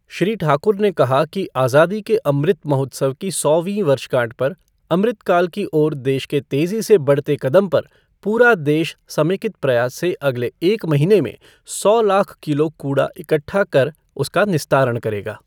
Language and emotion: Hindi, neutral